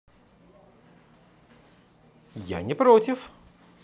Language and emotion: Russian, positive